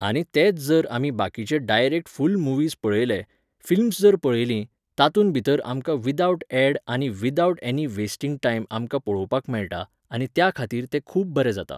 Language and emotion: Goan Konkani, neutral